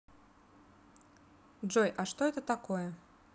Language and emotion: Russian, neutral